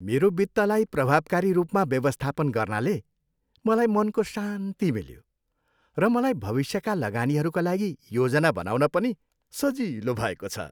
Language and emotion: Nepali, happy